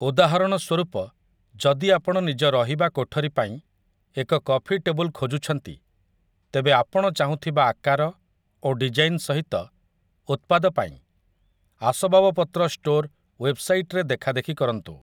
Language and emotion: Odia, neutral